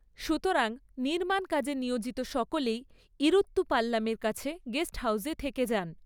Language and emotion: Bengali, neutral